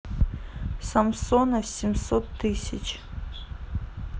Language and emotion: Russian, neutral